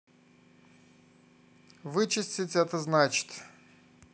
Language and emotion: Russian, neutral